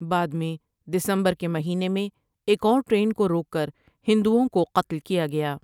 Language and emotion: Urdu, neutral